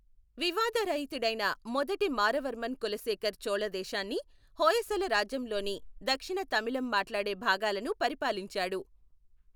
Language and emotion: Telugu, neutral